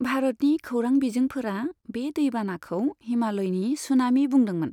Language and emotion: Bodo, neutral